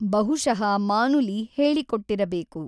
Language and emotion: Kannada, neutral